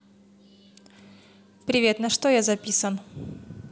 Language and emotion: Russian, neutral